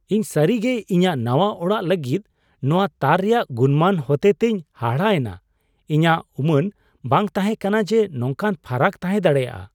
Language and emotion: Santali, surprised